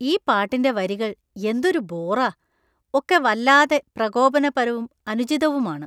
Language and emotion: Malayalam, disgusted